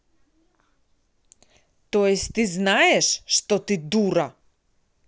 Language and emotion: Russian, angry